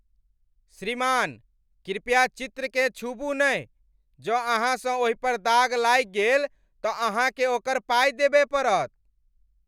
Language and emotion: Maithili, angry